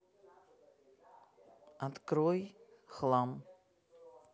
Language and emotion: Russian, neutral